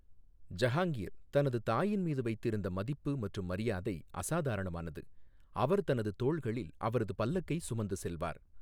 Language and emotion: Tamil, neutral